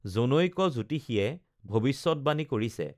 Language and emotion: Assamese, neutral